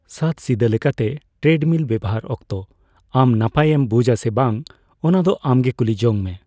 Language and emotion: Santali, neutral